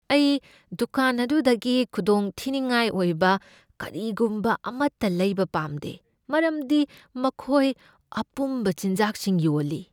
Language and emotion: Manipuri, fearful